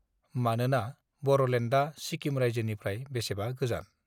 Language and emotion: Bodo, neutral